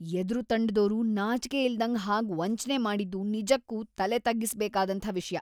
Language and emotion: Kannada, disgusted